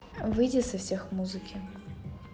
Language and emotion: Russian, neutral